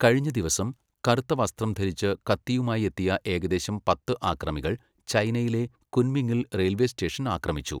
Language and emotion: Malayalam, neutral